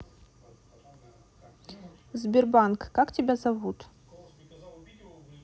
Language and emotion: Russian, neutral